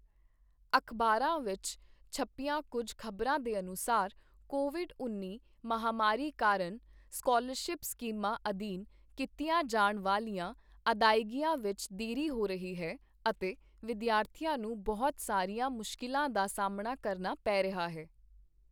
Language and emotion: Punjabi, neutral